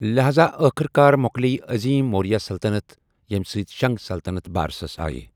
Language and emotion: Kashmiri, neutral